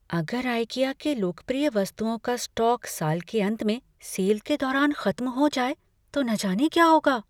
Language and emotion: Hindi, fearful